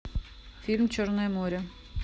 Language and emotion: Russian, neutral